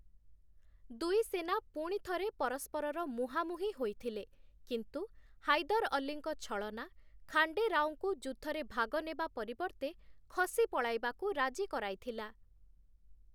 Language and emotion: Odia, neutral